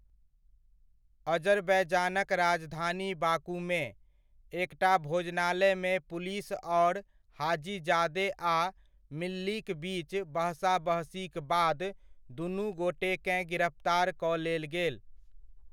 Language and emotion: Maithili, neutral